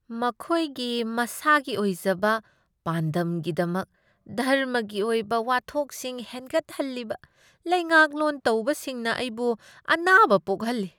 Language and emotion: Manipuri, disgusted